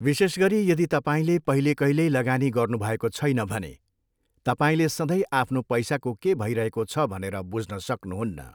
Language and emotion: Nepali, neutral